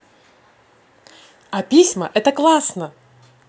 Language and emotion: Russian, positive